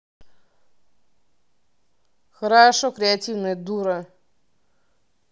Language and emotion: Russian, angry